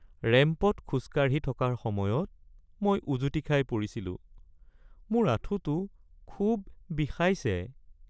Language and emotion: Assamese, sad